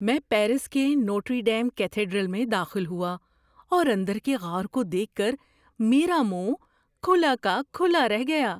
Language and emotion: Urdu, surprised